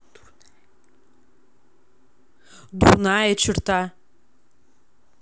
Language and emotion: Russian, neutral